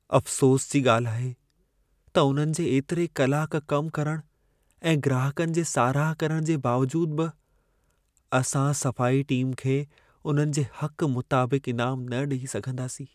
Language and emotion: Sindhi, sad